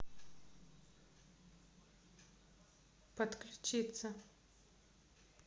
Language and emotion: Russian, neutral